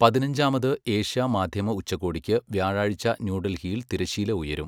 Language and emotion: Malayalam, neutral